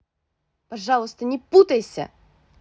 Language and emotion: Russian, angry